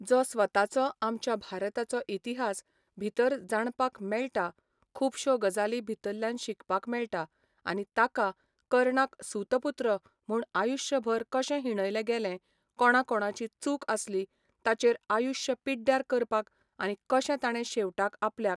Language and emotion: Goan Konkani, neutral